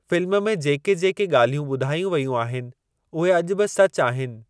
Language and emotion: Sindhi, neutral